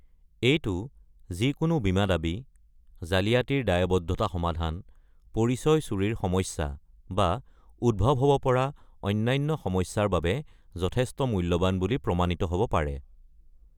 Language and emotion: Assamese, neutral